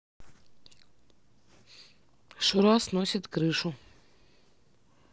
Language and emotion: Russian, neutral